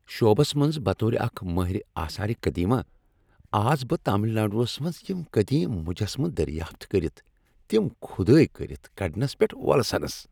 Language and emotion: Kashmiri, happy